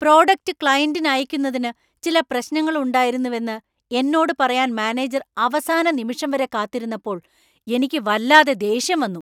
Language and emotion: Malayalam, angry